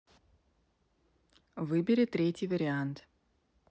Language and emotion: Russian, neutral